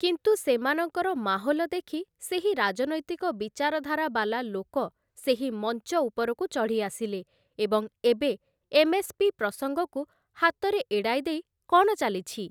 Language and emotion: Odia, neutral